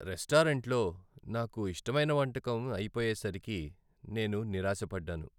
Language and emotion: Telugu, sad